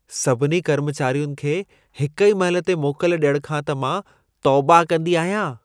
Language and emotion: Sindhi, disgusted